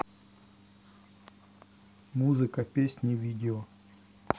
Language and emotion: Russian, neutral